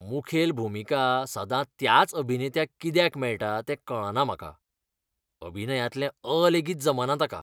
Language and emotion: Goan Konkani, disgusted